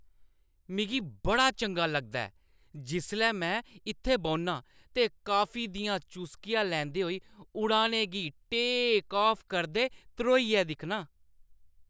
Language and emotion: Dogri, happy